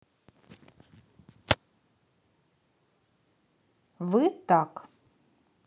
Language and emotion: Russian, neutral